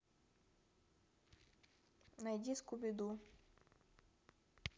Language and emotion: Russian, neutral